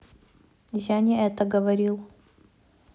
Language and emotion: Russian, neutral